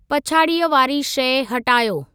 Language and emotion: Sindhi, neutral